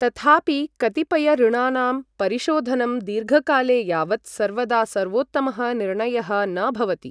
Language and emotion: Sanskrit, neutral